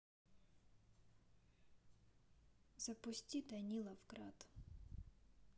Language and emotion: Russian, neutral